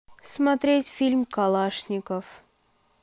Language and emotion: Russian, neutral